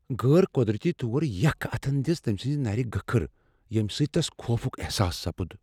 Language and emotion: Kashmiri, fearful